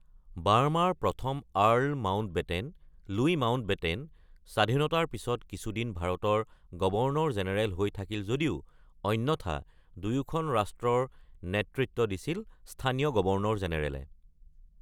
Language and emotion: Assamese, neutral